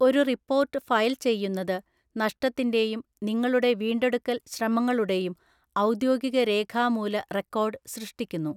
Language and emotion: Malayalam, neutral